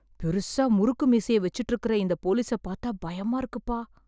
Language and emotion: Tamil, fearful